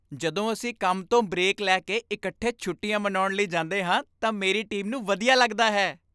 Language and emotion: Punjabi, happy